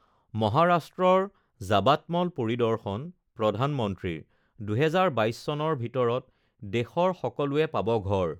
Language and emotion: Assamese, neutral